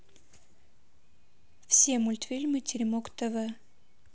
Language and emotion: Russian, neutral